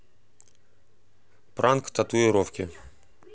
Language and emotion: Russian, neutral